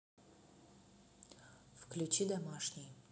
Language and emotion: Russian, neutral